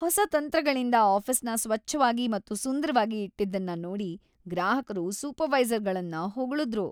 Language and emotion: Kannada, happy